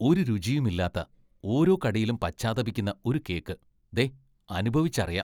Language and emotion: Malayalam, disgusted